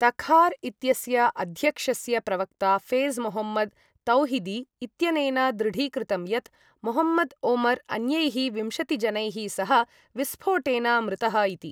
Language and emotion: Sanskrit, neutral